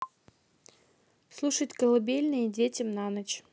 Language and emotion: Russian, neutral